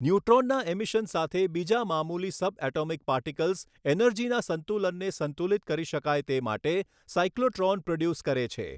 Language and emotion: Gujarati, neutral